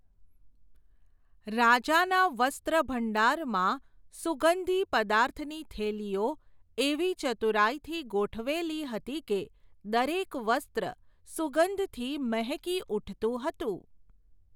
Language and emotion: Gujarati, neutral